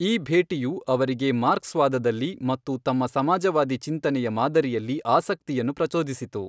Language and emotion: Kannada, neutral